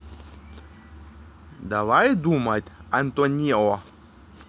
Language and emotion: Russian, positive